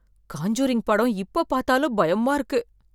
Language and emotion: Tamil, fearful